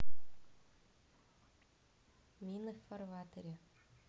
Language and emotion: Russian, neutral